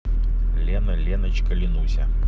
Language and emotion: Russian, positive